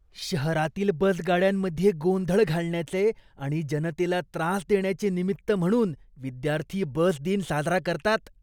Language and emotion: Marathi, disgusted